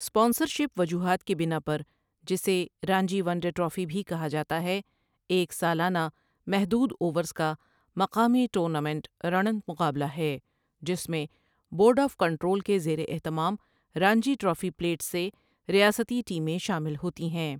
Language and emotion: Urdu, neutral